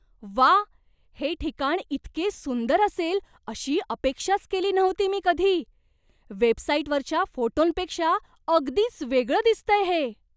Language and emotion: Marathi, surprised